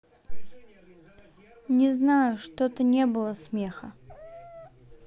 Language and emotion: Russian, sad